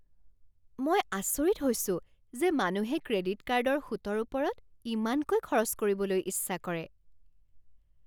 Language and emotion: Assamese, surprised